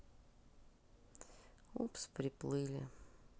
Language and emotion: Russian, sad